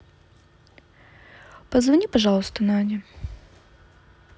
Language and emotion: Russian, neutral